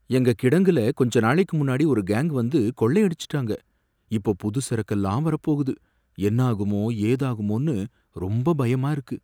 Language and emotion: Tamil, fearful